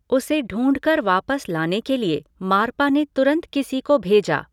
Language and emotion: Hindi, neutral